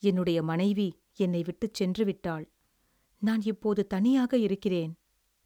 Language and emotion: Tamil, sad